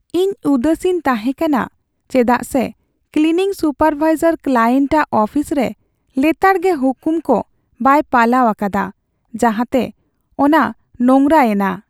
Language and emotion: Santali, sad